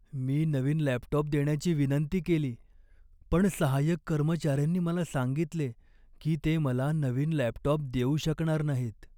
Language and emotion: Marathi, sad